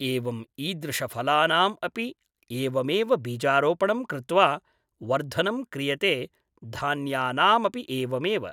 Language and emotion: Sanskrit, neutral